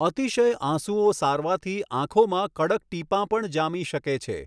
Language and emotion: Gujarati, neutral